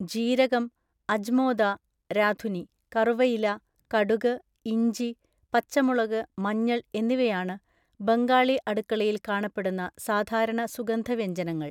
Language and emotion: Malayalam, neutral